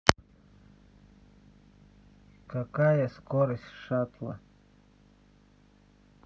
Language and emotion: Russian, neutral